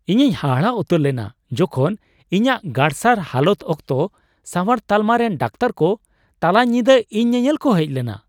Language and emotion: Santali, surprised